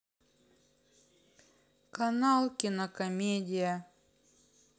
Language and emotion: Russian, sad